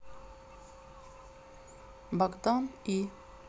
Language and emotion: Russian, neutral